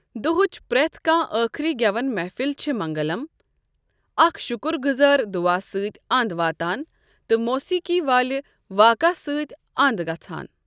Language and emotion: Kashmiri, neutral